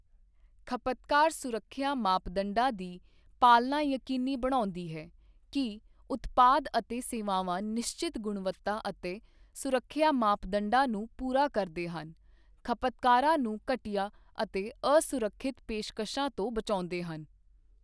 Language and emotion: Punjabi, neutral